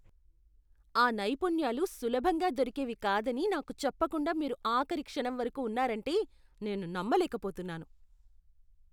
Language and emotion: Telugu, disgusted